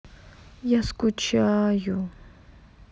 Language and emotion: Russian, sad